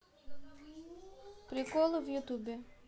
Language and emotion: Russian, neutral